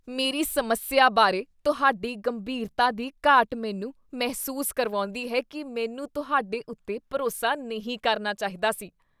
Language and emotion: Punjabi, disgusted